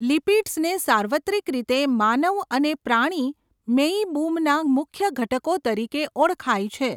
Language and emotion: Gujarati, neutral